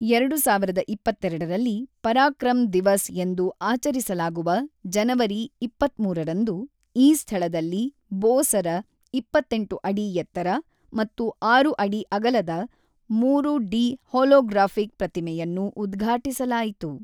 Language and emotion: Kannada, neutral